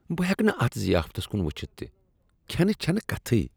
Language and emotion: Kashmiri, disgusted